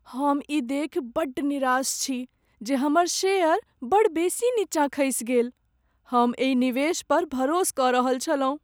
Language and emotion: Maithili, sad